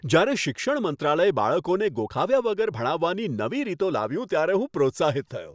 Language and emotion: Gujarati, happy